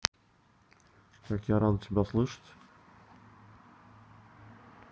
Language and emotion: Russian, neutral